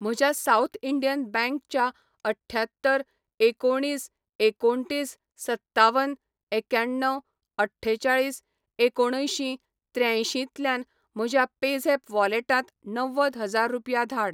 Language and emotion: Goan Konkani, neutral